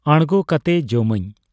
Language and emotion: Santali, neutral